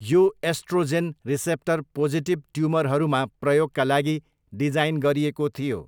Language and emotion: Nepali, neutral